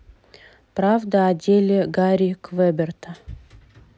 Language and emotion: Russian, neutral